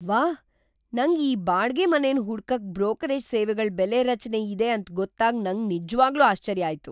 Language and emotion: Kannada, surprised